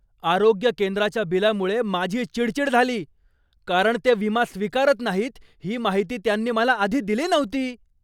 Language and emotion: Marathi, angry